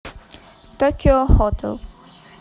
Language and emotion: Russian, neutral